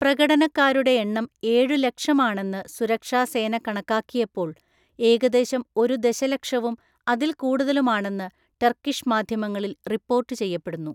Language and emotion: Malayalam, neutral